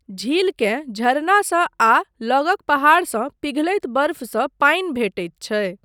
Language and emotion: Maithili, neutral